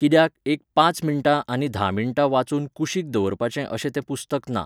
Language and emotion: Goan Konkani, neutral